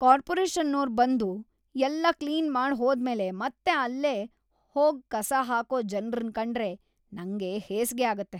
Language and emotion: Kannada, disgusted